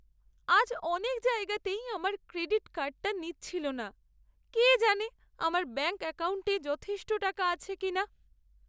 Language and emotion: Bengali, sad